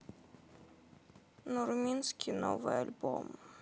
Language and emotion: Russian, sad